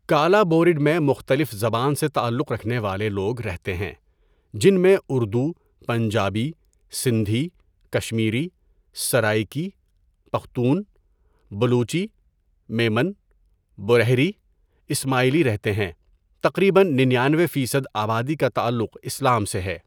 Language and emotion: Urdu, neutral